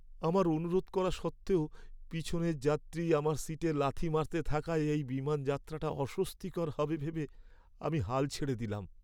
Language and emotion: Bengali, sad